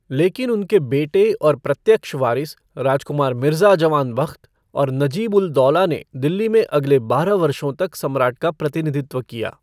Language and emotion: Hindi, neutral